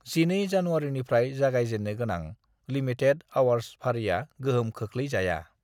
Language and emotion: Bodo, neutral